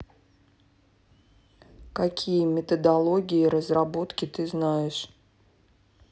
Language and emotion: Russian, neutral